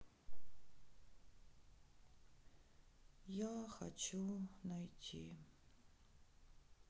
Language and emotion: Russian, sad